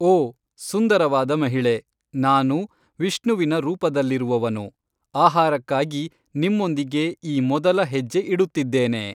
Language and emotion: Kannada, neutral